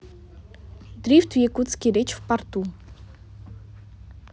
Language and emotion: Russian, neutral